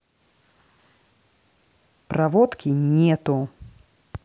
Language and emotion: Russian, angry